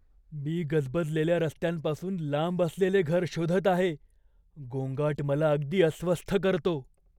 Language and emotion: Marathi, fearful